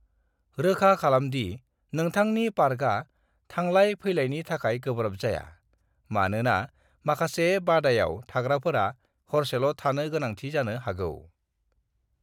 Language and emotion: Bodo, neutral